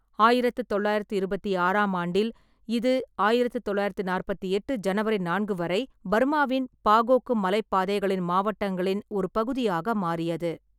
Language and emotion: Tamil, neutral